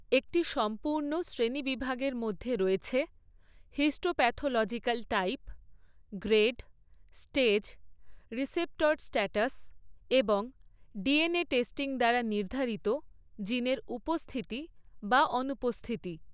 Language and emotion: Bengali, neutral